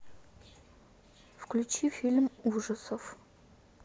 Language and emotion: Russian, neutral